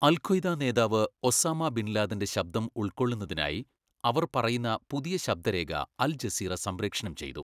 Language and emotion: Malayalam, neutral